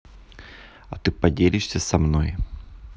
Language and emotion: Russian, neutral